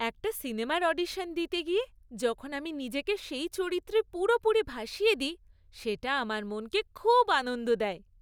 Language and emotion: Bengali, happy